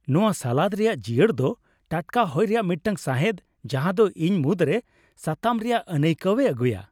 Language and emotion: Santali, happy